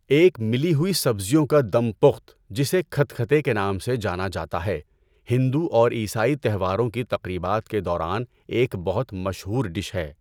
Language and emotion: Urdu, neutral